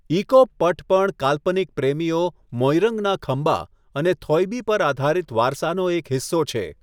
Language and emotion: Gujarati, neutral